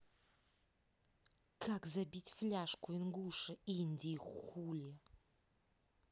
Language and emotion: Russian, neutral